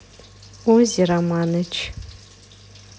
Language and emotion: Russian, neutral